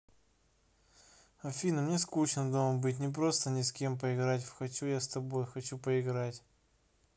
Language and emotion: Russian, sad